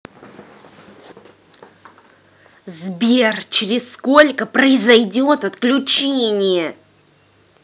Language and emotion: Russian, angry